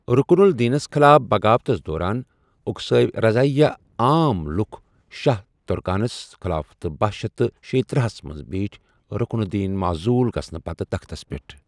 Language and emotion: Kashmiri, neutral